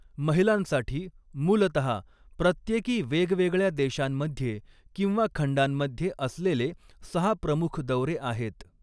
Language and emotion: Marathi, neutral